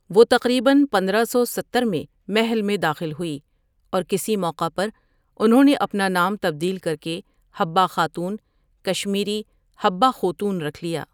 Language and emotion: Urdu, neutral